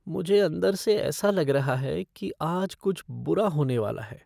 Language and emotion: Hindi, fearful